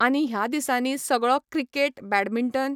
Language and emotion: Goan Konkani, neutral